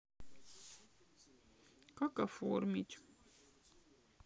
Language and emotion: Russian, sad